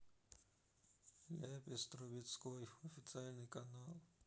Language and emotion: Russian, sad